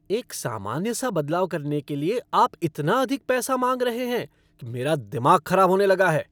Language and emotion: Hindi, angry